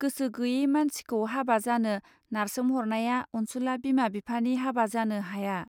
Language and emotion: Bodo, neutral